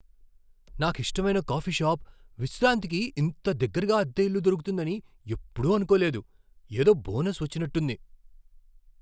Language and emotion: Telugu, surprised